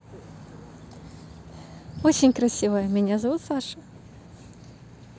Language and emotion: Russian, positive